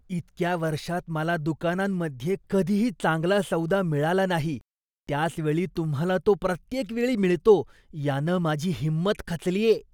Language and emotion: Marathi, disgusted